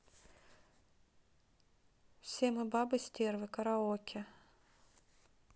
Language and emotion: Russian, neutral